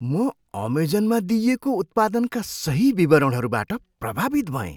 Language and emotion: Nepali, surprised